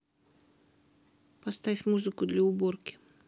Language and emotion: Russian, neutral